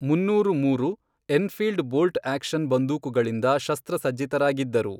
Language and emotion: Kannada, neutral